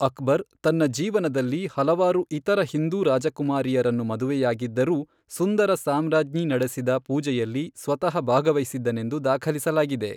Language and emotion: Kannada, neutral